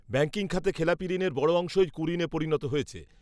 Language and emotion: Bengali, neutral